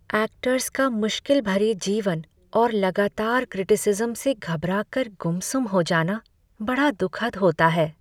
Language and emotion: Hindi, sad